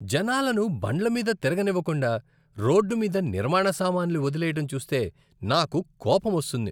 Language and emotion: Telugu, disgusted